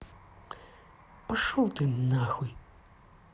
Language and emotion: Russian, angry